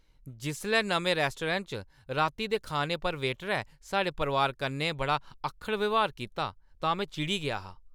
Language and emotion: Dogri, angry